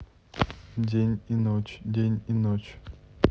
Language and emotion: Russian, neutral